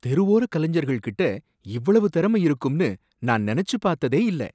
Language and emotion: Tamil, surprised